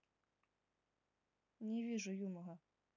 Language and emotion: Russian, neutral